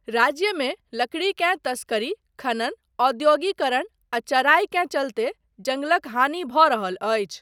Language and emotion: Maithili, neutral